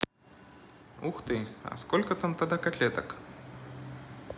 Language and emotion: Russian, positive